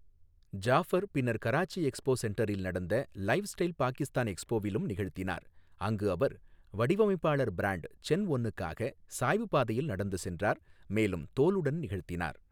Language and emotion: Tamil, neutral